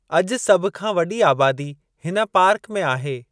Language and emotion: Sindhi, neutral